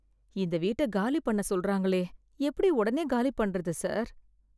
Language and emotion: Tamil, fearful